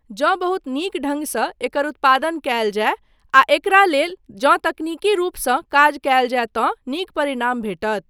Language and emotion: Maithili, neutral